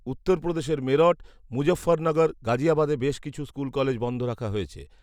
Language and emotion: Bengali, neutral